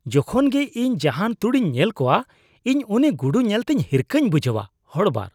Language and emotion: Santali, disgusted